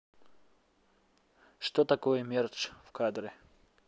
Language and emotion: Russian, neutral